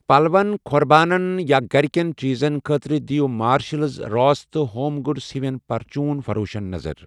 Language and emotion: Kashmiri, neutral